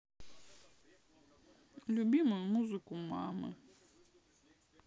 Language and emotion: Russian, sad